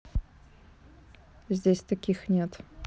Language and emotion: Russian, neutral